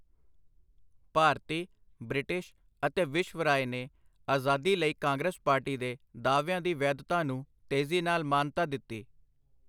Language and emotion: Punjabi, neutral